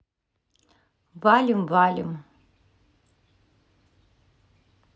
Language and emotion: Russian, neutral